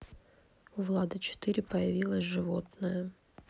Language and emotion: Russian, neutral